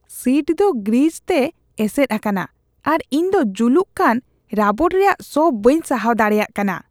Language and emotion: Santali, disgusted